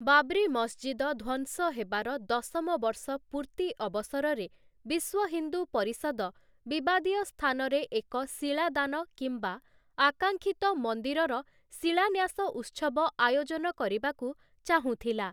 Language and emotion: Odia, neutral